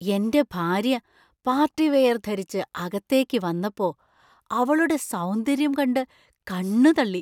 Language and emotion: Malayalam, surprised